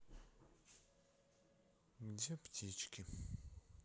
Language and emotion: Russian, sad